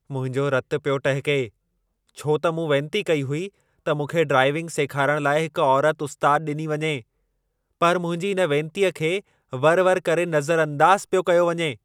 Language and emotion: Sindhi, angry